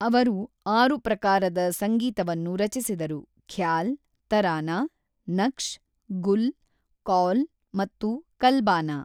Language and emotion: Kannada, neutral